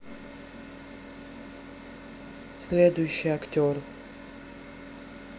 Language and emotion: Russian, neutral